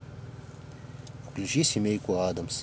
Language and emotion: Russian, neutral